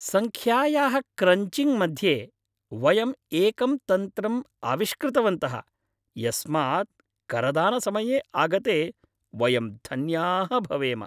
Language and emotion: Sanskrit, happy